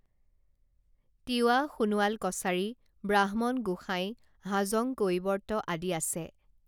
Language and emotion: Assamese, neutral